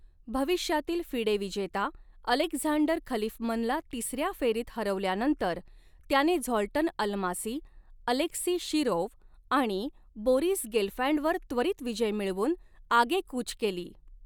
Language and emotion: Marathi, neutral